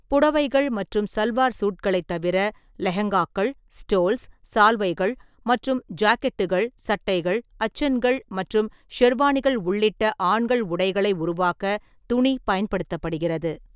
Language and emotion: Tamil, neutral